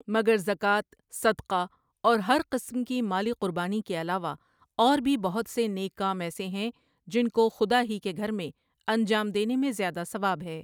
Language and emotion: Urdu, neutral